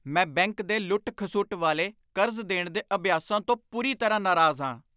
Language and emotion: Punjabi, angry